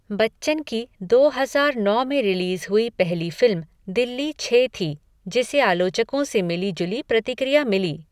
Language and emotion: Hindi, neutral